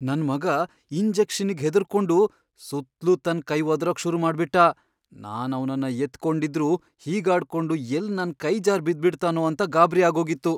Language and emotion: Kannada, fearful